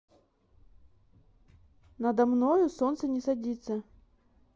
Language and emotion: Russian, neutral